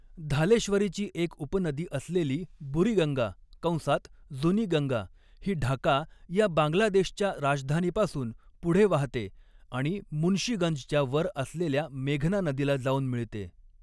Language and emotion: Marathi, neutral